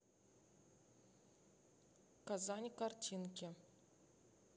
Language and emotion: Russian, neutral